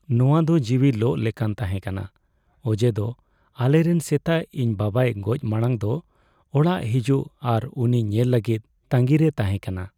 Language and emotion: Santali, sad